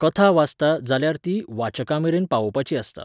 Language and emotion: Goan Konkani, neutral